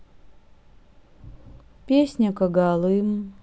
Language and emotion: Russian, sad